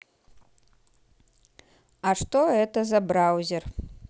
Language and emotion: Russian, neutral